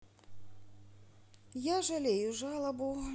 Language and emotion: Russian, sad